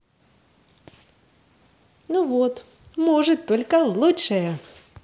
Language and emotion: Russian, positive